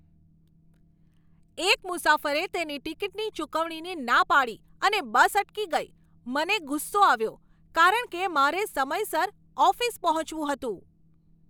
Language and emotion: Gujarati, angry